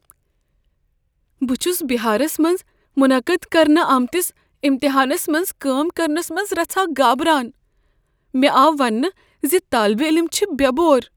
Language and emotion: Kashmiri, fearful